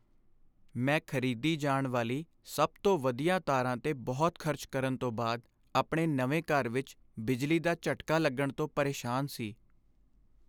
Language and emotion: Punjabi, sad